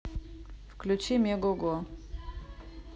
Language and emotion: Russian, neutral